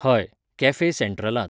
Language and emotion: Goan Konkani, neutral